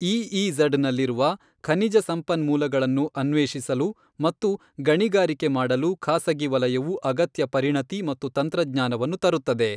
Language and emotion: Kannada, neutral